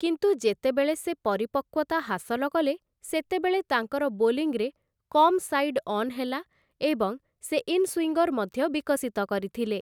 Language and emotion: Odia, neutral